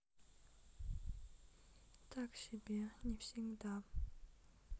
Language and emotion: Russian, sad